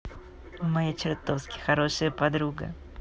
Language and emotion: Russian, positive